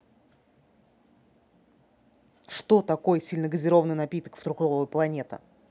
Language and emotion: Russian, angry